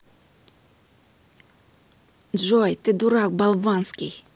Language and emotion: Russian, angry